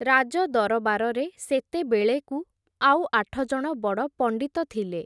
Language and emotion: Odia, neutral